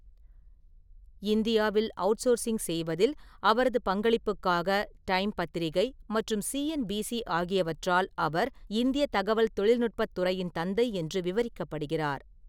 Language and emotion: Tamil, neutral